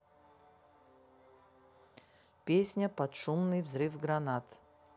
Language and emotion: Russian, neutral